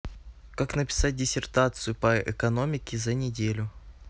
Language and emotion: Russian, neutral